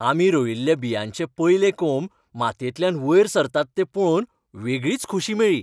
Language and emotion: Goan Konkani, happy